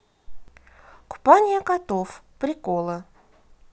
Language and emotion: Russian, positive